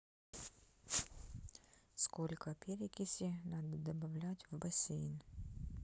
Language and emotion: Russian, neutral